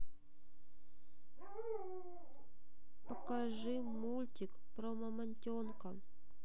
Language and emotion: Russian, sad